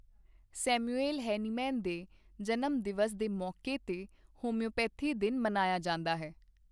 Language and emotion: Punjabi, neutral